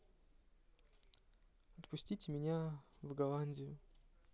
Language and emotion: Russian, neutral